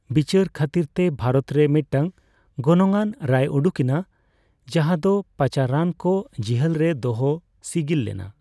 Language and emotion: Santali, neutral